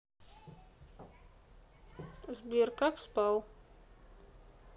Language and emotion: Russian, neutral